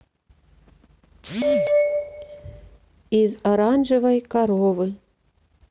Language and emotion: Russian, neutral